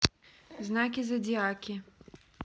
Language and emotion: Russian, neutral